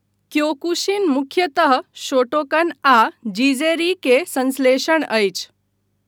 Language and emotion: Maithili, neutral